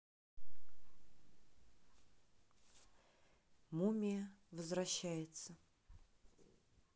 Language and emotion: Russian, neutral